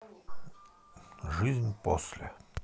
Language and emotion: Russian, sad